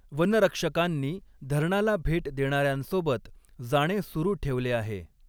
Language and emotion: Marathi, neutral